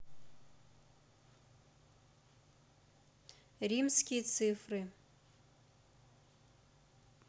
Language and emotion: Russian, neutral